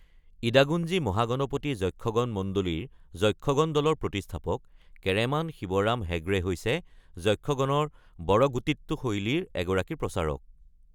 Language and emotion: Assamese, neutral